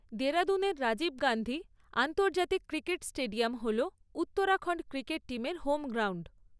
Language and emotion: Bengali, neutral